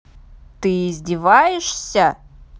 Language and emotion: Russian, angry